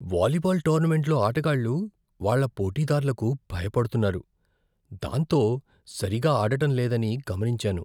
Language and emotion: Telugu, fearful